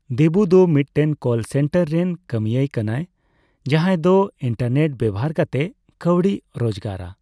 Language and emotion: Santali, neutral